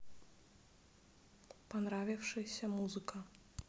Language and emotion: Russian, neutral